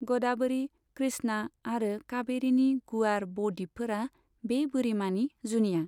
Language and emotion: Bodo, neutral